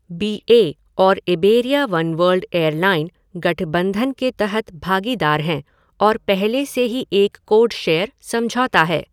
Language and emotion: Hindi, neutral